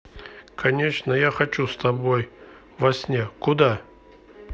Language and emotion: Russian, neutral